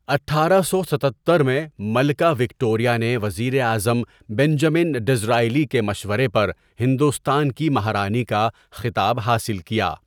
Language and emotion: Urdu, neutral